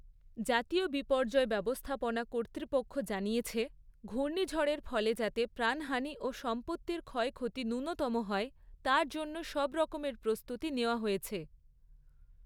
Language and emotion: Bengali, neutral